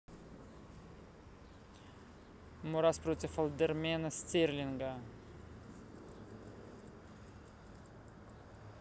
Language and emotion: Russian, neutral